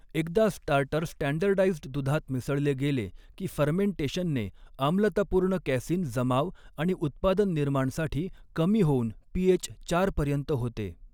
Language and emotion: Marathi, neutral